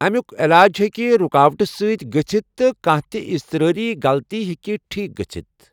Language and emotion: Kashmiri, neutral